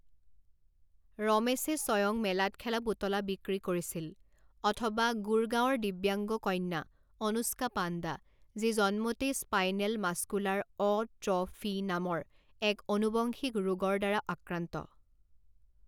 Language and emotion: Assamese, neutral